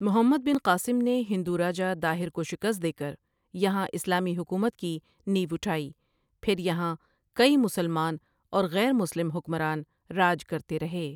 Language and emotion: Urdu, neutral